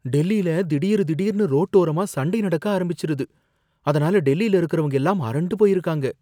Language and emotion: Tamil, fearful